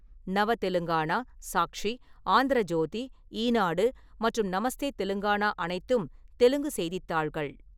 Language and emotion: Tamil, neutral